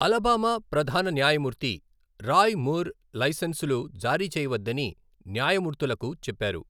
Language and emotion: Telugu, neutral